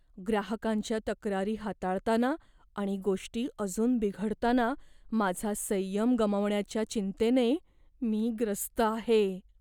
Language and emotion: Marathi, fearful